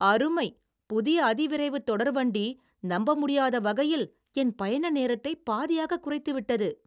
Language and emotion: Tamil, surprised